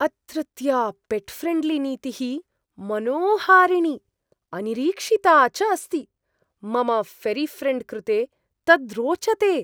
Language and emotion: Sanskrit, surprised